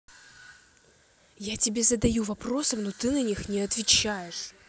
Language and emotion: Russian, angry